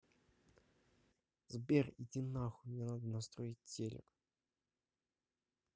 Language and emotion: Russian, neutral